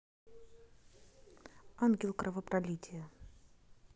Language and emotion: Russian, neutral